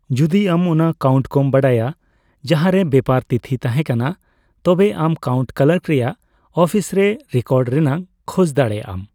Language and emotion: Santali, neutral